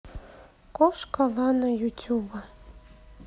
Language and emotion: Russian, neutral